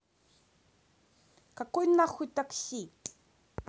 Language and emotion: Russian, angry